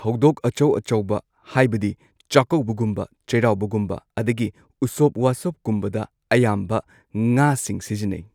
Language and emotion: Manipuri, neutral